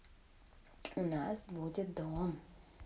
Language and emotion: Russian, positive